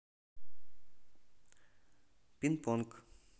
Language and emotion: Russian, neutral